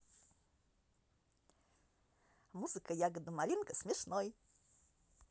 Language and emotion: Russian, positive